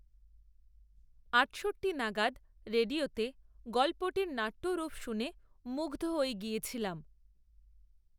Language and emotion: Bengali, neutral